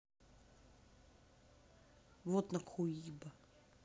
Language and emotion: Russian, angry